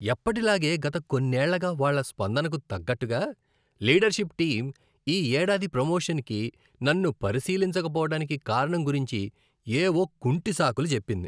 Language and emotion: Telugu, disgusted